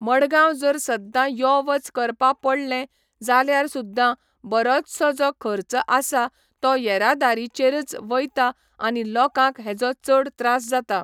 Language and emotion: Goan Konkani, neutral